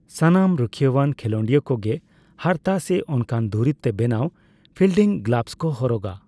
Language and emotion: Santali, neutral